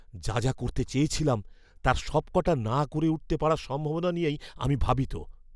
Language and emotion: Bengali, fearful